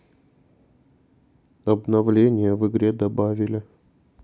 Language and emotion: Russian, sad